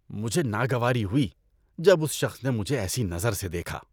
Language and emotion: Urdu, disgusted